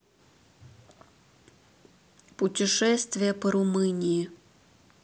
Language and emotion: Russian, neutral